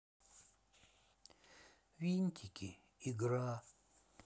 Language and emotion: Russian, sad